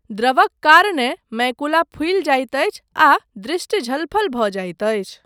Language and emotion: Maithili, neutral